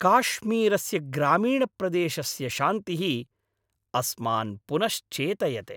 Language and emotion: Sanskrit, happy